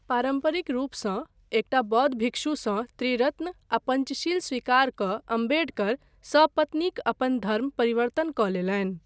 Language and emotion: Maithili, neutral